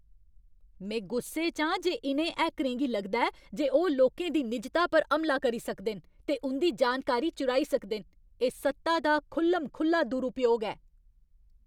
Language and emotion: Dogri, angry